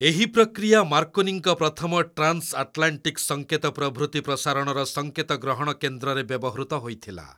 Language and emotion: Odia, neutral